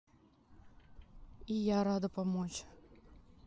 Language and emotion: Russian, neutral